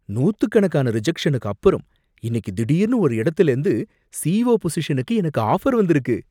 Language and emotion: Tamil, surprised